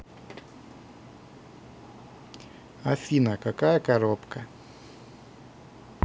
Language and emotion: Russian, neutral